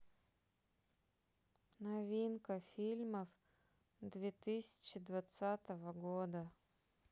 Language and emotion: Russian, sad